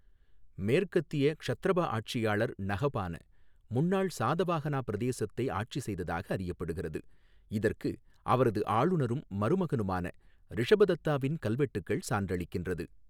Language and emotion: Tamil, neutral